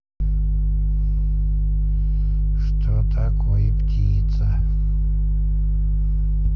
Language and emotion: Russian, neutral